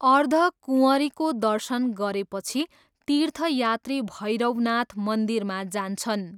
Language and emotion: Nepali, neutral